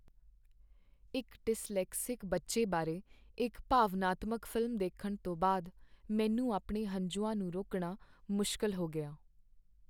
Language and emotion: Punjabi, sad